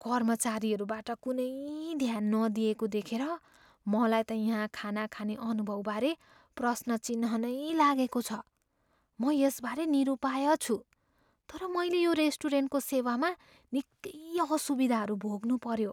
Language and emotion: Nepali, fearful